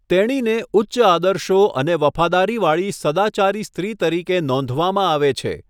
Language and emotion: Gujarati, neutral